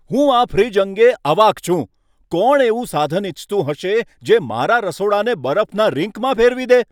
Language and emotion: Gujarati, angry